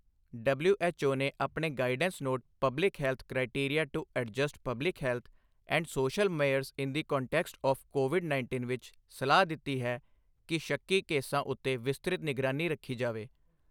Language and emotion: Punjabi, neutral